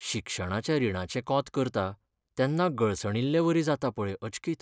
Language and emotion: Goan Konkani, sad